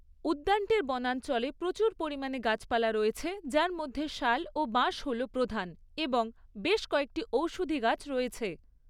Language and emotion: Bengali, neutral